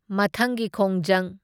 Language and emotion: Manipuri, neutral